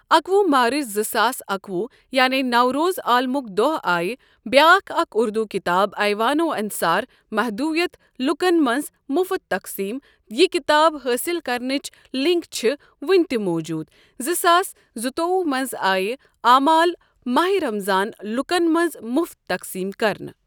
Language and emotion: Kashmiri, neutral